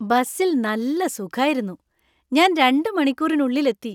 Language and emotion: Malayalam, happy